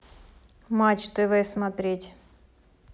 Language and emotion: Russian, neutral